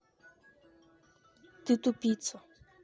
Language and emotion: Russian, angry